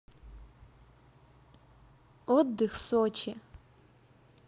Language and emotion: Russian, positive